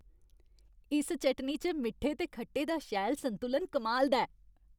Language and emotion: Dogri, happy